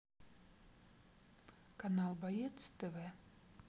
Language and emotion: Russian, neutral